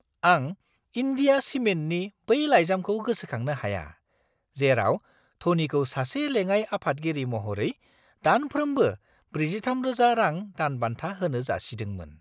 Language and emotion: Bodo, surprised